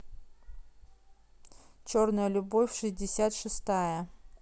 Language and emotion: Russian, neutral